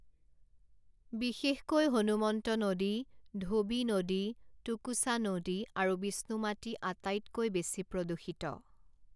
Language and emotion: Assamese, neutral